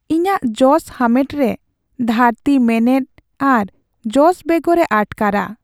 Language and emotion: Santali, sad